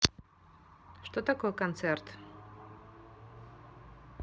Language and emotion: Russian, neutral